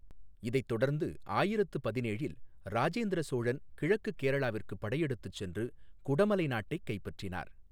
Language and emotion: Tamil, neutral